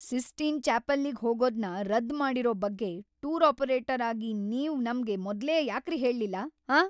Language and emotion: Kannada, angry